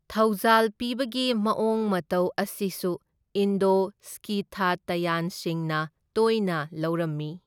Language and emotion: Manipuri, neutral